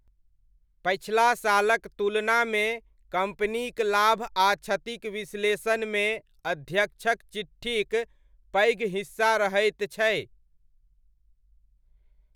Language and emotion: Maithili, neutral